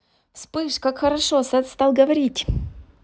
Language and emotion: Russian, positive